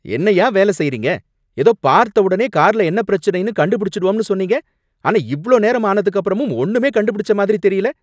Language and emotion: Tamil, angry